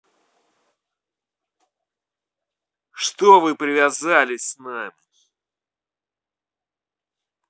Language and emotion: Russian, angry